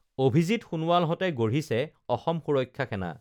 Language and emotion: Assamese, neutral